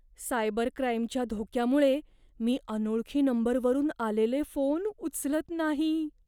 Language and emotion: Marathi, fearful